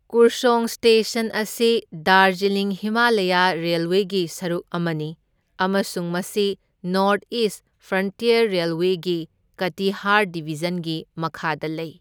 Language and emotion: Manipuri, neutral